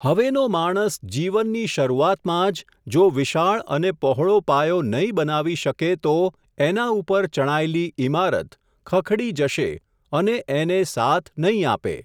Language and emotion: Gujarati, neutral